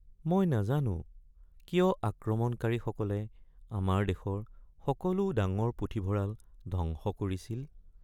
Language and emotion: Assamese, sad